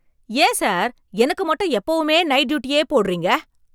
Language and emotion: Tamil, angry